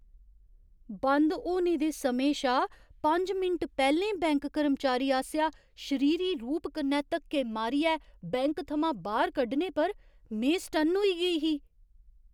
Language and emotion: Dogri, surprised